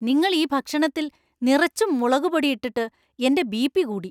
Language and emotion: Malayalam, angry